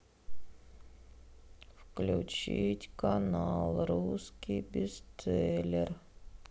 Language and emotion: Russian, sad